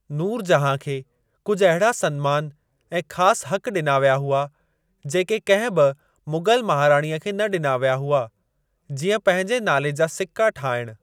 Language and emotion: Sindhi, neutral